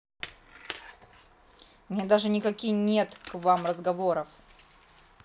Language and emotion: Russian, angry